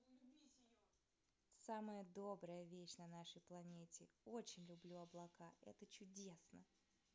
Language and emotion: Russian, positive